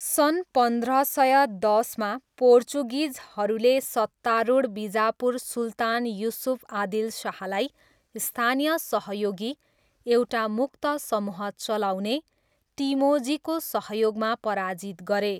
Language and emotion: Nepali, neutral